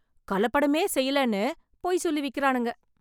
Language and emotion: Tamil, angry